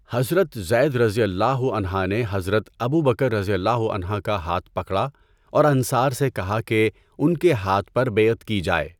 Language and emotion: Urdu, neutral